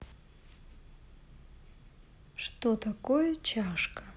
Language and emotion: Russian, neutral